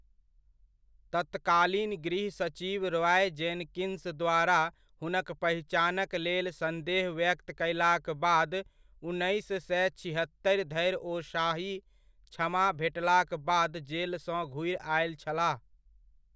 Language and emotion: Maithili, neutral